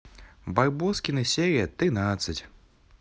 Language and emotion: Russian, positive